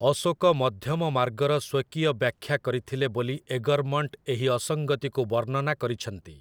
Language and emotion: Odia, neutral